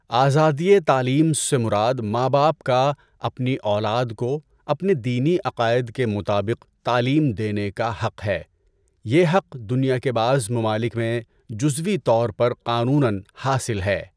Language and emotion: Urdu, neutral